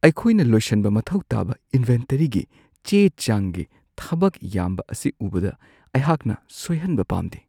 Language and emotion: Manipuri, fearful